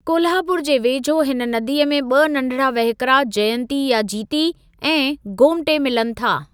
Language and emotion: Sindhi, neutral